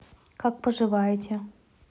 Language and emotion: Russian, neutral